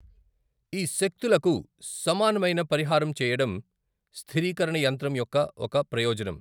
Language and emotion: Telugu, neutral